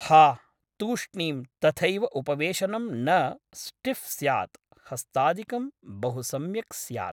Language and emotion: Sanskrit, neutral